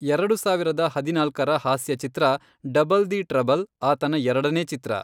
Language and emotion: Kannada, neutral